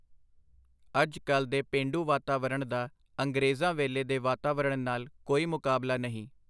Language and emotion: Punjabi, neutral